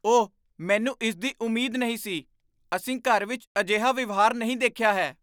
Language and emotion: Punjabi, surprised